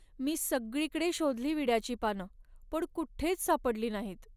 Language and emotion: Marathi, sad